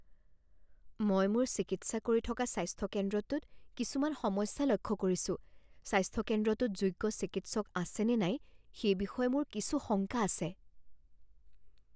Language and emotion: Assamese, fearful